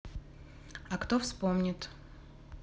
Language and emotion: Russian, neutral